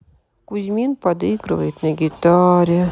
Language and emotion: Russian, sad